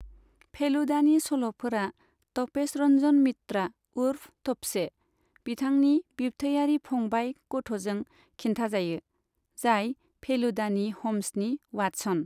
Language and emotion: Bodo, neutral